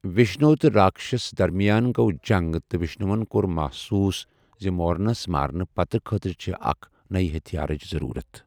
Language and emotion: Kashmiri, neutral